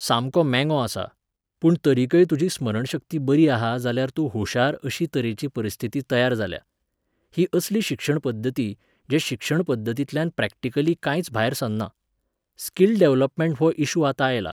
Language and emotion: Goan Konkani, neutral